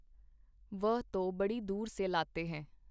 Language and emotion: Punjabi, neutral